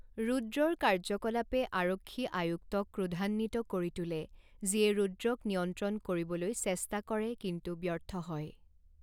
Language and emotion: Assamese, neutral